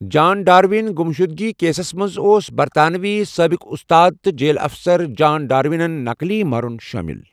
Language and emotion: Kashmiri, neutral